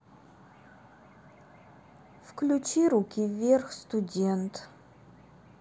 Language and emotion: Russian, sad